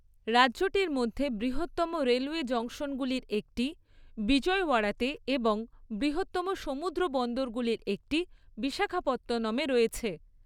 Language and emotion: Bengali, neutral